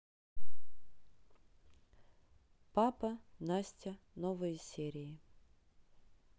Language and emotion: Russian, neutral